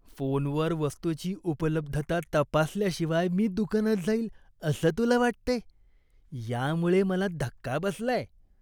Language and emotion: Marathi, disgusted